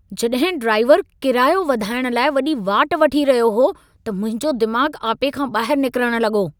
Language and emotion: Sindhi, angry